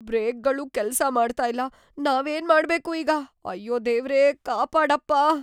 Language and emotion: Kannada, fearful